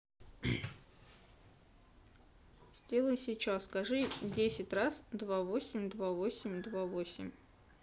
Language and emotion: Russian, neutral